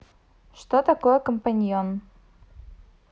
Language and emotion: Russian, neutral